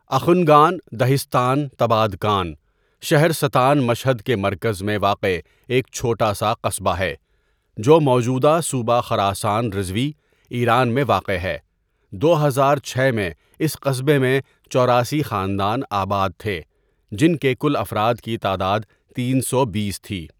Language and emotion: Urdu, neutral